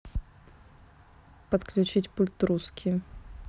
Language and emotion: Russian, neutral